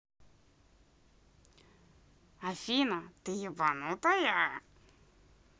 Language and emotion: Russian, angry